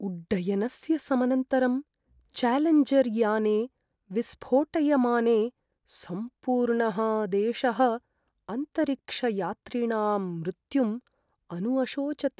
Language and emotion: Sanskrit, sad